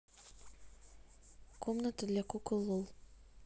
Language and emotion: Russian, neutral